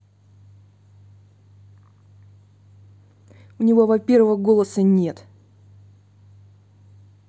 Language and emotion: Russian, angry